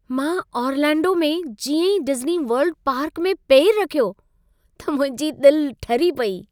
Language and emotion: Sindhi, happy